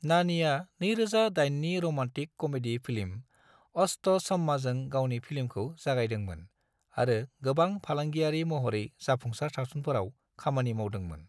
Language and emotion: Bodo, neutral